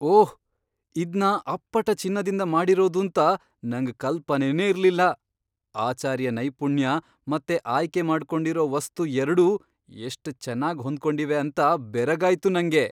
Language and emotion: Kannada, surprised